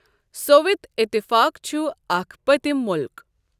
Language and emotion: Kashmiri, neutral